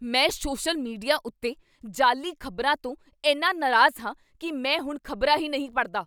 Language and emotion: Punjabi, angry